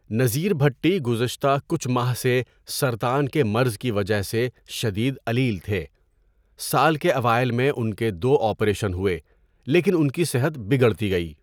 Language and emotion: Urdu, neutral